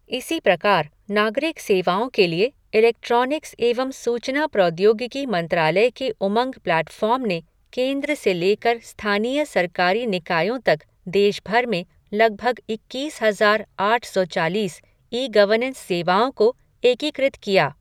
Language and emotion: Hindi, neutral